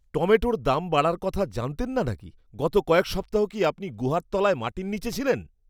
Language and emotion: Bengali, disgusted